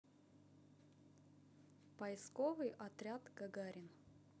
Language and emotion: Russian, neutral